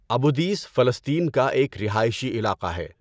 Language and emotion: Urdu, neutral